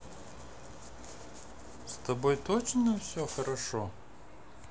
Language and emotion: Russian, neutral